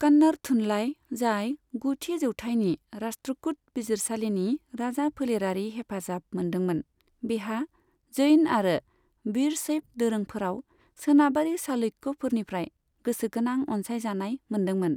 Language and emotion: Bodo, neutral